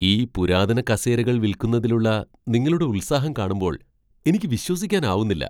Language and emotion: Malayalam, surprised